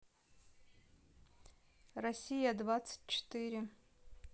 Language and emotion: Russian, neutral